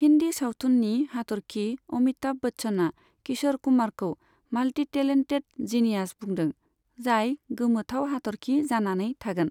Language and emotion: Bodo, neutral